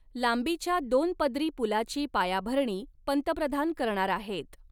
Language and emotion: Marathi, neutral